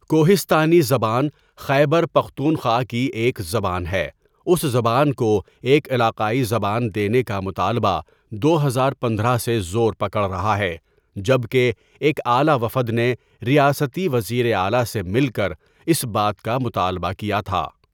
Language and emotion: Urdu, neutral